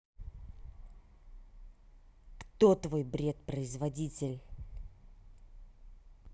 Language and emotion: Russian, angry